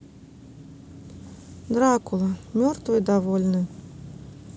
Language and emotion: Russian, neutral